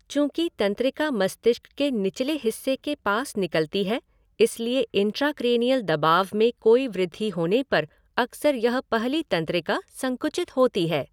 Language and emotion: Hindi, neutral